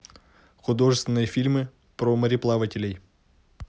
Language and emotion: Russian, neutral